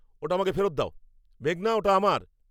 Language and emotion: Bengali, angry